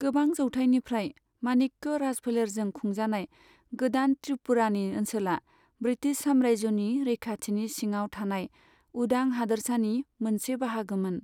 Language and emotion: Bodo, neutral